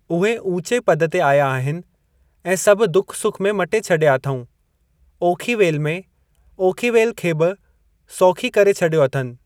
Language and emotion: Sindhi, neutral